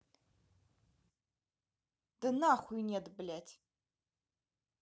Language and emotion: Russian, angry